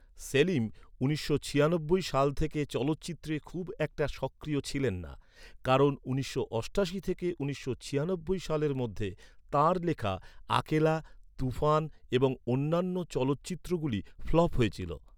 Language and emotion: Bengali, neutral